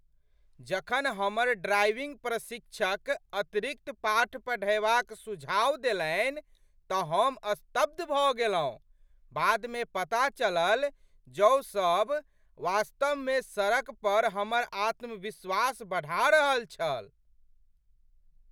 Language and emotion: Maithili, surprised